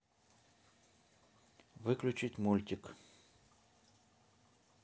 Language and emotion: Russian, neutral